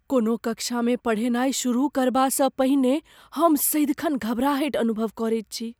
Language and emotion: Maithili, fearful